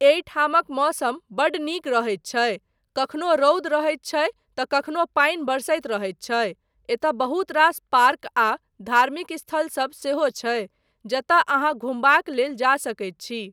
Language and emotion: Maithili, neutral